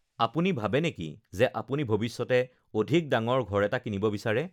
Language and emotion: Assamese, neutral